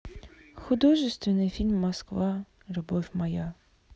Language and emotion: Russian, sad